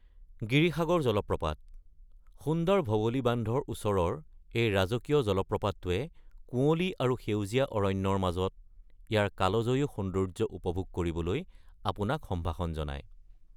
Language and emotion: Assamese, neutral